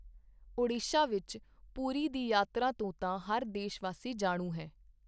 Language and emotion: Punjabi, neutral